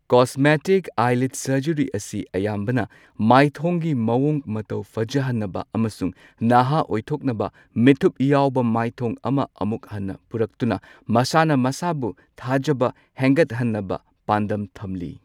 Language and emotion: Manipuri, neutral